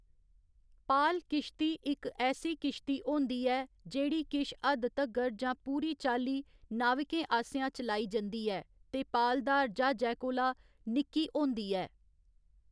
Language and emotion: Dogri, neutral